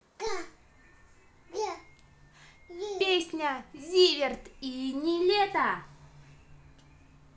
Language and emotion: Russian, positive